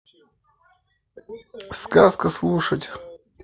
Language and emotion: Russian, neutral